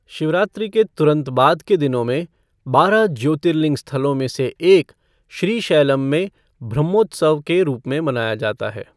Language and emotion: Hindi, neutral